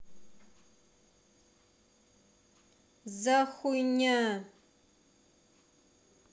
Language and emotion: Russian, neutral